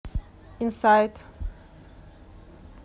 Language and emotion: Russian, neutral